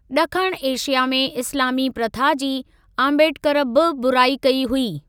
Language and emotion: Sindhi, neutral